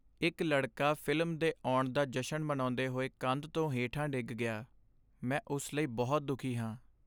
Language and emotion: Punjabi, sad